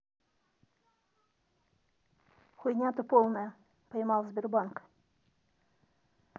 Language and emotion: Russian, angry